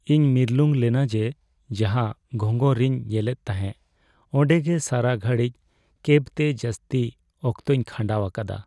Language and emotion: Santali, sad